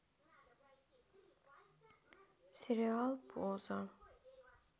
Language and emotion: Russian, sad